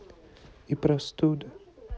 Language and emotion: Russian, sad